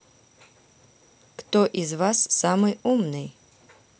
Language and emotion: Russian, neutral